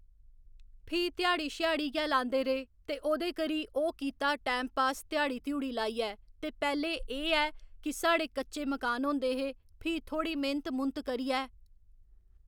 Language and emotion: Dogri, neutral